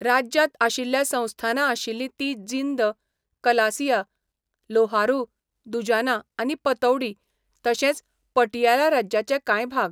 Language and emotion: Goan Konkani, neutral